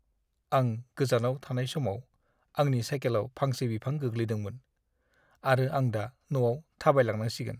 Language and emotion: Bodo, sad